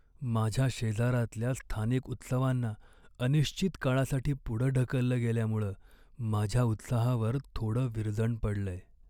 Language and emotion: Marathi, sad